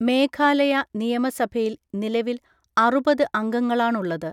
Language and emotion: Malayalam, neutral